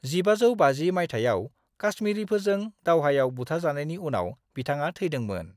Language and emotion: Bodo, neutral